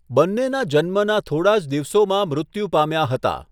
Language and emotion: Gujarati, neutral